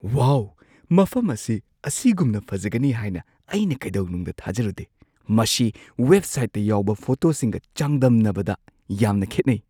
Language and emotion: Manipuri, surprised